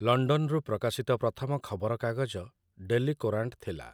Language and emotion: Odia, neutral